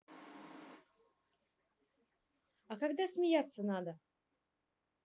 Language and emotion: Russian, neutral